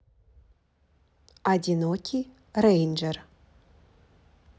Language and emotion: Russian, neutral